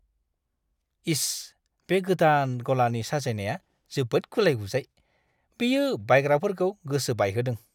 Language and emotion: Bodo, disgusted